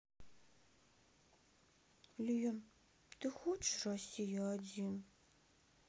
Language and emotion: Russian, sad